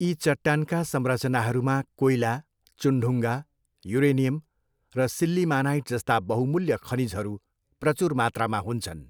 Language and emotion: Nepali, neutral